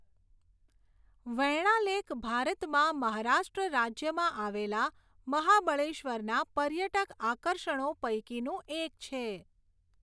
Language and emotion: Gujarati, neutral